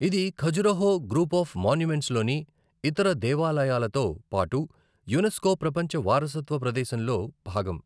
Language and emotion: Telugu, neutral